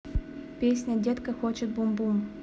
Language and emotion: Russian, neutral